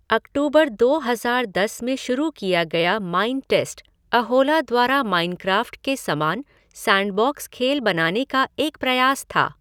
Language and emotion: Hindi, neutral